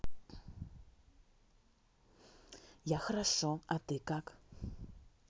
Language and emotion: Russian, neutral